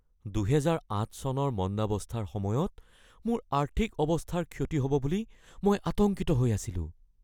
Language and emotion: Assamese, fearful